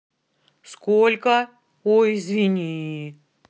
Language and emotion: Russian, angry